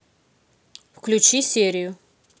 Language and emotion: Russian, neutral